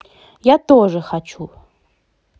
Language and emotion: Russian, positive